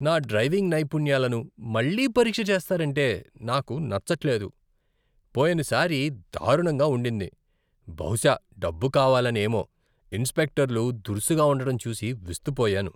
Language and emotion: Telugu, disgusted